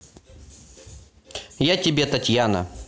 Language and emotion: Russian, neutral